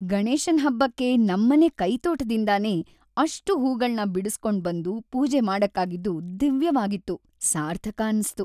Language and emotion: Kannada, happy